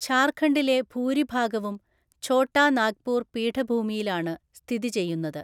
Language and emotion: Malayalam, neutral